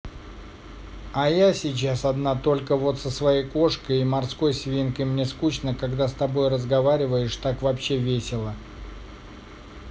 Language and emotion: Russian, neutral